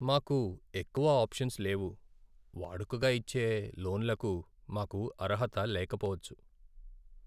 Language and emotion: Telugu, sad